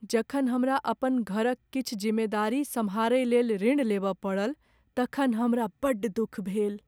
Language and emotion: Maithili, sad